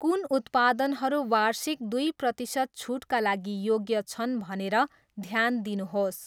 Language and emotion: Nepali, neutral